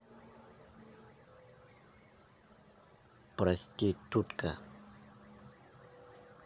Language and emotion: Russian, neutral